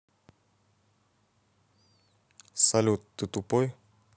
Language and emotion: Russian, neutral